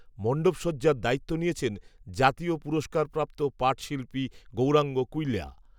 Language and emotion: Bengali, neutral